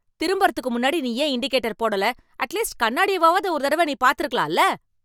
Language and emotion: Tamil, angry